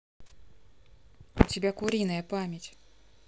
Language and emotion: Russian, neutral